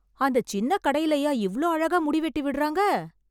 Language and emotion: Tamil, surprised